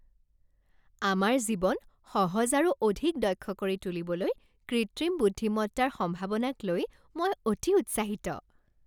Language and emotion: Assamese, happy